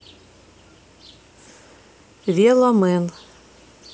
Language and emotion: Russian, neutral